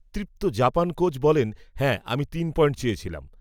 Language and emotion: Bengali, neutral